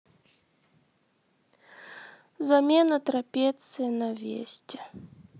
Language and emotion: Russian, sad